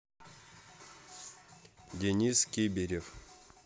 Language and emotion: Russian, neutral